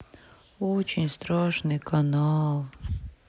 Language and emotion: Russian, sad